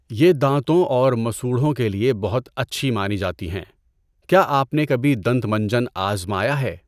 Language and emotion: Urdu, neutral